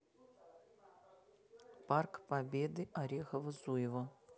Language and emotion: Russian, neutral